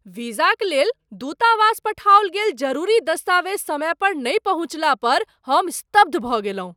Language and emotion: Maithili, surprised